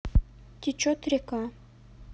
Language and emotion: Russian, neutral